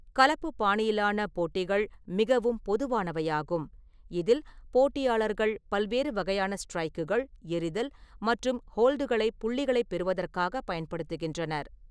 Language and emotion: Tamil, neutral